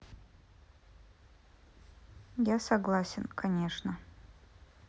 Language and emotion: Russian, neutral